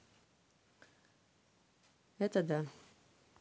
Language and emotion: Russian, neutral